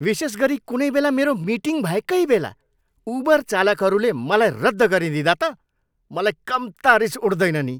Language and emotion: Nepali, angry